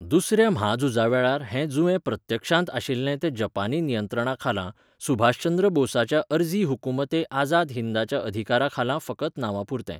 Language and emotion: Goan Konkani, neutral